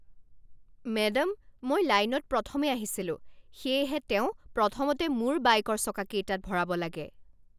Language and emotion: Assamese, angry